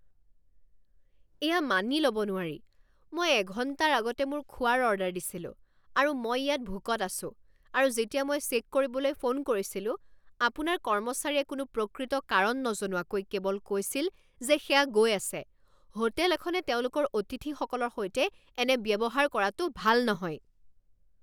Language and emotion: Assamese, angry